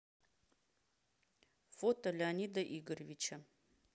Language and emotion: Russian, neutral